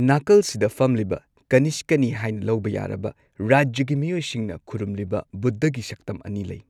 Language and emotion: Manipuri, neutral